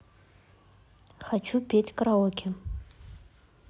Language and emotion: Russian, neutral